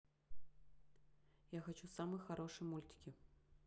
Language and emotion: Russian, neutral